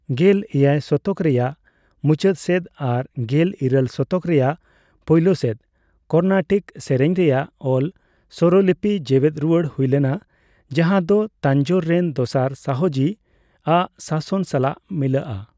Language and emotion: Santali, neutral